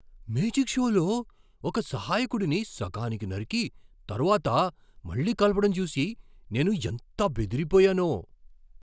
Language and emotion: Telugu, surprised